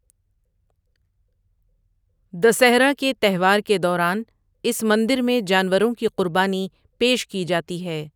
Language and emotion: Urdu, neutral